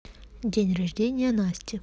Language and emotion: Russian, neutral